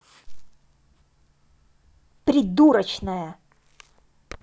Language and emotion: Russian, angry